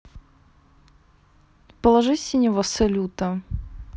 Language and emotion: Russian, neutral